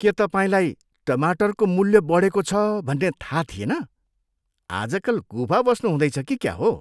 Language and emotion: Nepali, disgusted